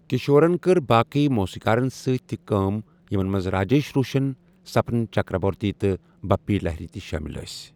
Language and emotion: Kashmiri, neutral